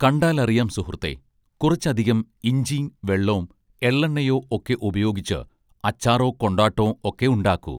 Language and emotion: Malayalam, neutral